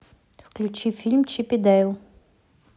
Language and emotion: Russian, neutral